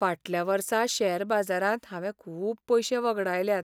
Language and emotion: Goan Konkani, sad